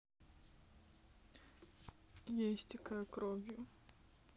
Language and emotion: Russian, sad